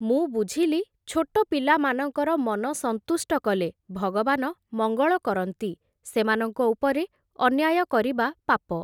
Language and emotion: Odia, neutral